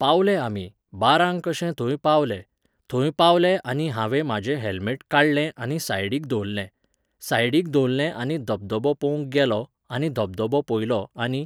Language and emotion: Goan Konkani, neutral